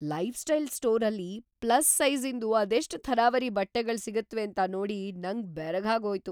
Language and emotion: Kannada, surprised